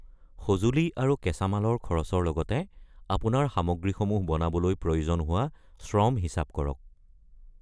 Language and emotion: Assamese, neutral